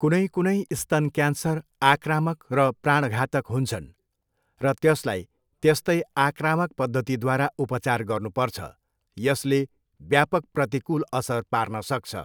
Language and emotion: Nepali, neutral